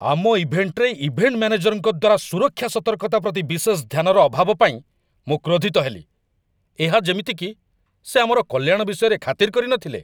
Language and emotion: Odia, angry